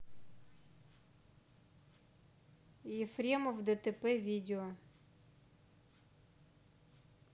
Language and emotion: Russian, neutral